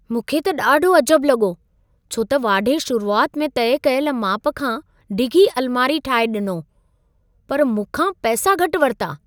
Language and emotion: Sindhi, surprised